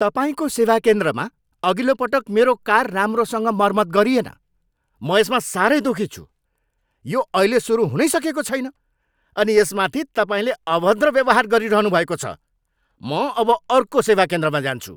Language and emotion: Nepali, angry